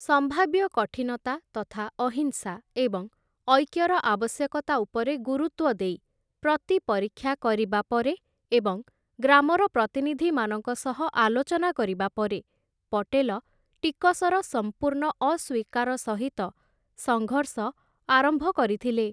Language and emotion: Odia, neutral